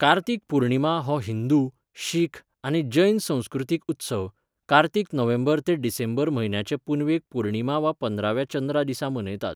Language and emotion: Goan Konkani, neutral